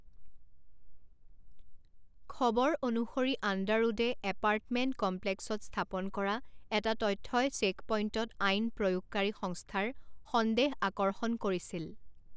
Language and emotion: Assamese, neutral